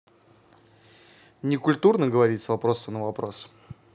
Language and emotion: Russian, neutral